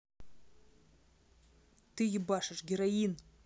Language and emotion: Russian, angry